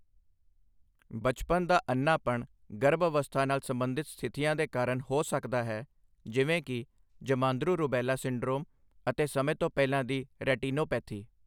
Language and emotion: Punjabi, neutral